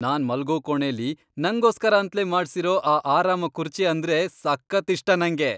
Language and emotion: Kannada, happy